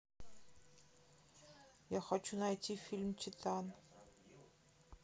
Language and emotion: Russian, neutral